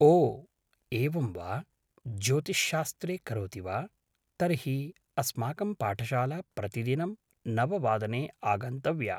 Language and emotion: Sanskrit, neutral